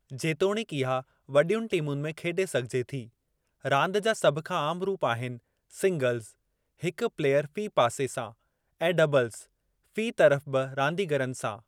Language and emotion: Sindhi, neutral